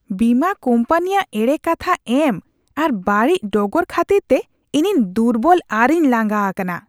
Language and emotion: Santali, disgusted